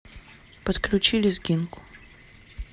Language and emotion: Russian, neutral